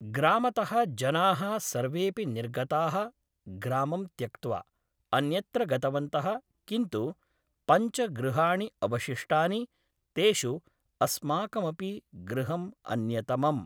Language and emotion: Sanskrit, neutral